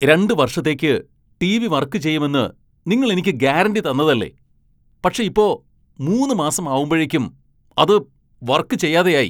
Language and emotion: Malayalam, angry